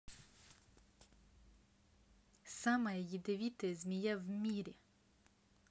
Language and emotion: Russian, neutral